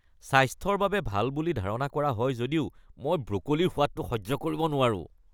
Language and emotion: Assamese, disgusted